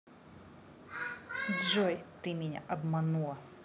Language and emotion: Russian, angry